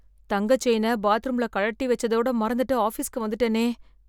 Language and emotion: Tamil, fearful